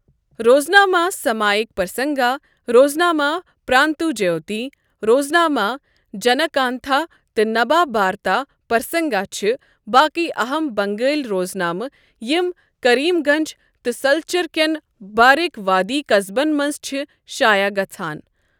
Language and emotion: Kashmiri, neutral